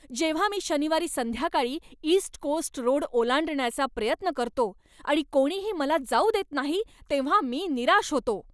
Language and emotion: Marathi, angry